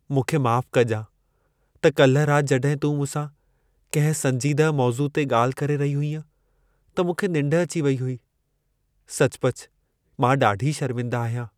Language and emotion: Sindhi, sad